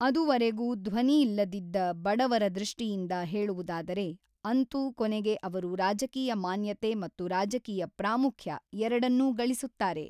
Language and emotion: Kannada, neutral